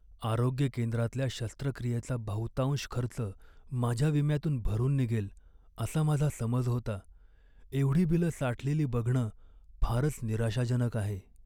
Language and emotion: Marathi, sad